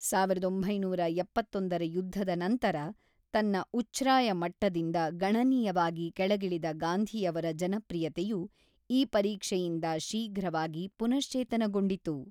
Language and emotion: Kannada, neutral